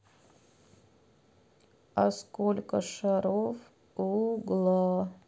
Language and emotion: Russian, sad